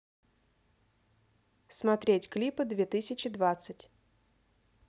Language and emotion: Russian, neutral